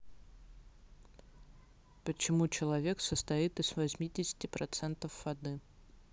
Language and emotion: Russian, neutral